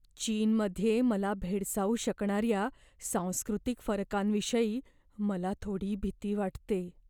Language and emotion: Marathi, fearful